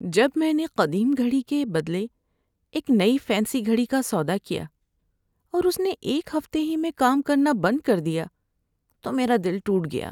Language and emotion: Urdu, sad